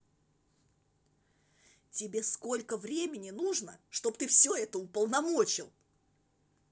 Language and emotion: Russian, angry